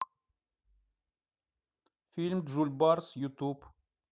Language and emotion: Russian, neutral